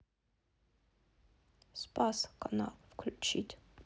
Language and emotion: Russian, sad